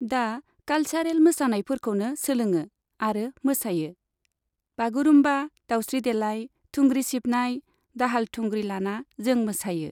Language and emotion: Bodo, neutral